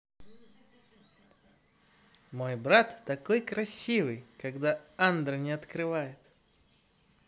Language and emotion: Russian, positive